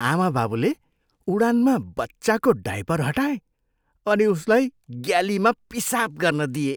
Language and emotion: Nepali, disgusted